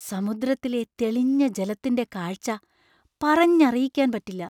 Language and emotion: Malayalam, surprised